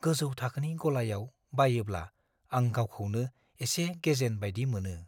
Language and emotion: Bodo, fearful